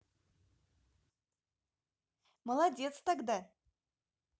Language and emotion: Russian, positive